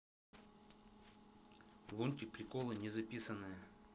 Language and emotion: Russian, neutral